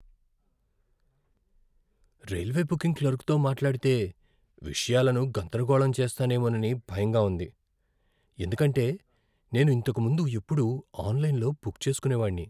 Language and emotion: Telugu, fearful